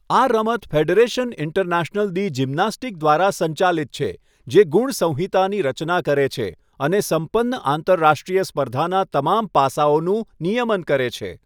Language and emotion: Gujarati, neutral